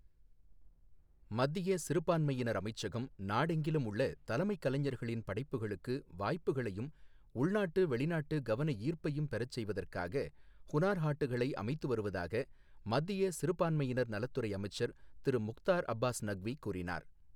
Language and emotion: Tamil, neutral